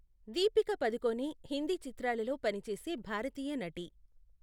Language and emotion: Telugu, neutral